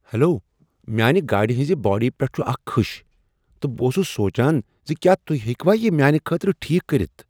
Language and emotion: Kashmiri, surprised